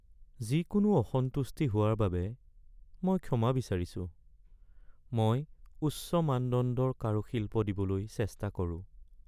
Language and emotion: Assamese, sad